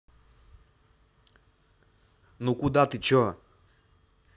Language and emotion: Russian, angry